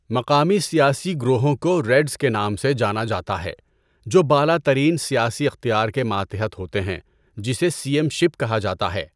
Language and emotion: Urdu, neutral